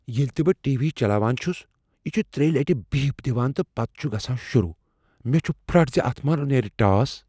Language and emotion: Kashmiri, fearful